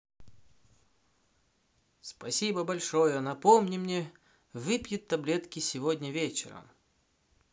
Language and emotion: Russian, positive